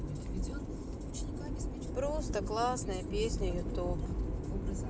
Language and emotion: Russian, sad